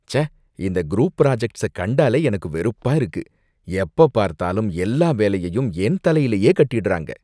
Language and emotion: Tamil, disgusted